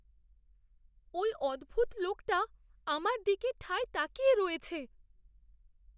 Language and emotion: Bengali, fearful